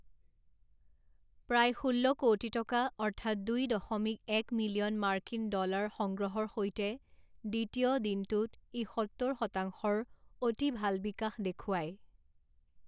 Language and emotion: Assamese, neutral